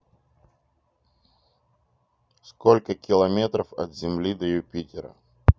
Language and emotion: Russian, neutral